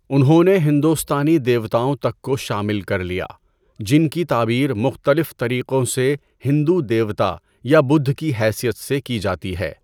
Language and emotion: Urdu, neutral